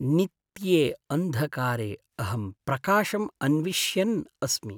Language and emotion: Sanskrit, sad